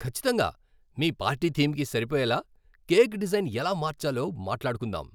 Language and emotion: Telugu, happy